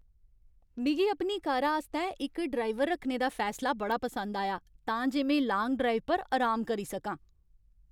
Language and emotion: Dogri, happy